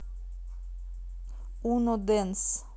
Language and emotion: Russian, neutral